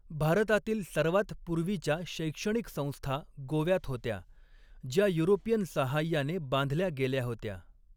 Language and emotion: Marathi, neutral